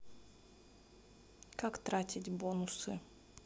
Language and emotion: Russian, neutral